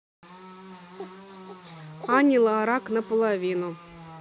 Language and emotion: Russian, neutral